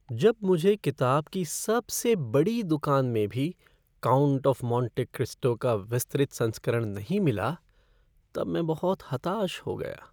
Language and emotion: Hindi, sad